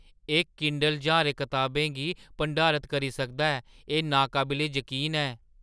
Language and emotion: Dogri, surprised